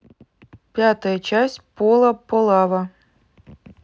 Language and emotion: Russian, neutral